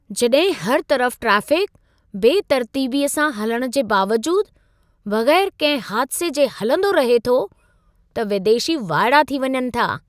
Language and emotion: Sindhi, surprised